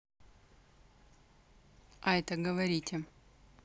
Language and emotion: Russian, neutral